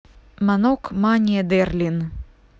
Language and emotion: Russian, neutral